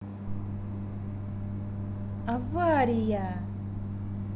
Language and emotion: Russian, positive